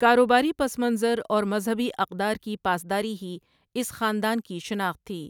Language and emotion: Urdu, neutral